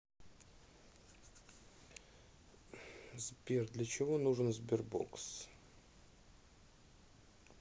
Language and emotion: Russian, neutral